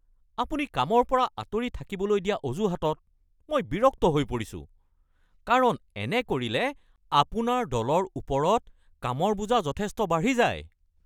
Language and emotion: Assamese, angry